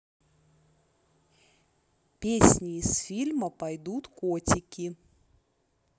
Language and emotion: Russian, neutral